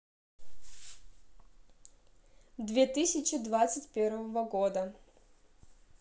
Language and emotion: Russian, neutral